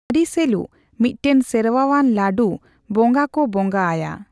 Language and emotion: Santali, neutral